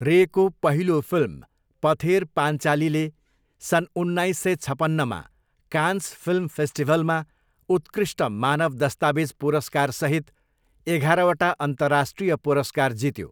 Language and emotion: Nepali, neutral